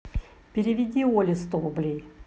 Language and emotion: Russian, neutral